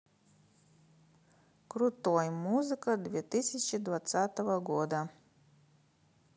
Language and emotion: Russian, neutral